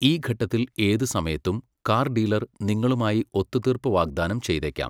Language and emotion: Malayalam, neutral